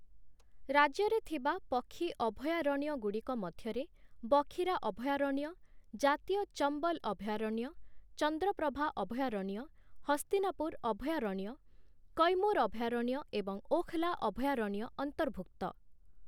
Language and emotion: Odia, neutral